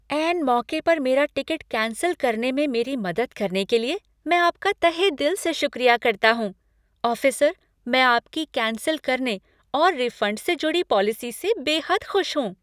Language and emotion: Hindi, happy